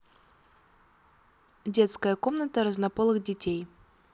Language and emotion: Russian, neutral